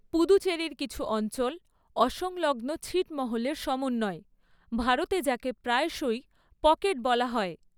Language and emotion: Bengali, neutral